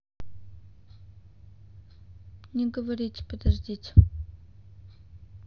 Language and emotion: Russian, neutral